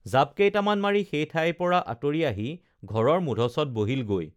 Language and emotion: Assamese, neutral